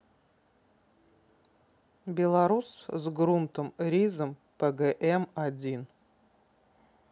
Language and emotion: Russian, neutral